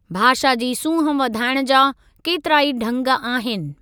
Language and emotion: Sindhi, neutral